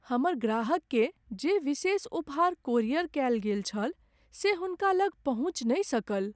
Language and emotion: Maithili, sad